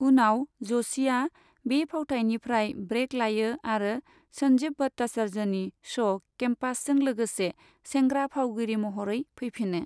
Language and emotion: Bodo, neutral